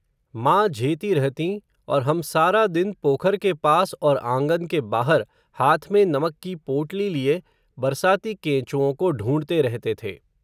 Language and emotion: Hindi, neutral